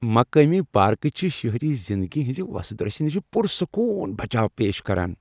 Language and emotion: Kashmiri, happy